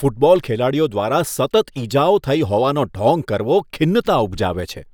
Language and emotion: Gujarati, disgusted